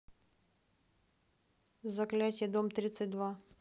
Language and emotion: Russian, neutral